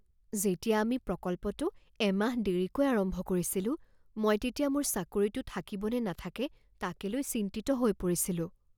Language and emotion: Assamese, fearful